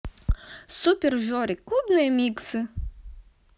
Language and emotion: Russian, positive